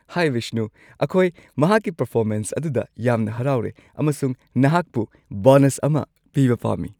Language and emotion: Manipuri, happy